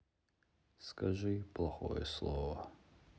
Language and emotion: Russian, sad